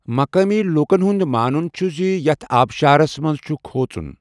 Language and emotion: Kashmiri, neutral